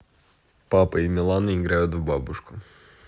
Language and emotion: Russian, neutral